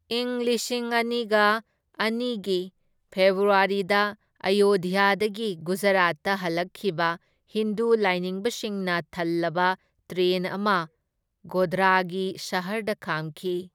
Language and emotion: Manipuri, neutral